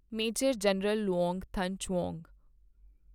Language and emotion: Punjabi, neutral